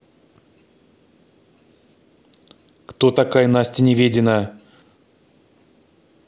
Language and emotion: Russian, angry